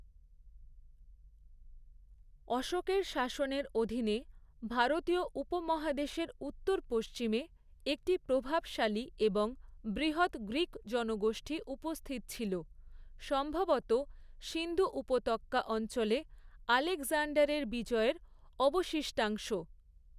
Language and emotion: Bengali, neutral